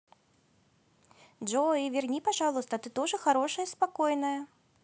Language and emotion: Russian, positive